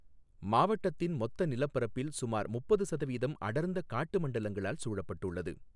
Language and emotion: Tamil, neutral